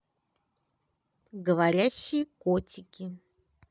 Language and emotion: Russian, positive